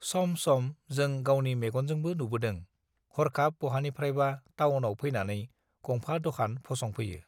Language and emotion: Bodo, neutral